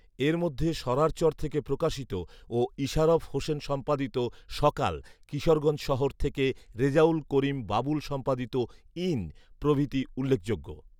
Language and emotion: Bengali, neutral